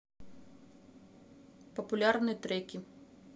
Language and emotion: Russian, neutral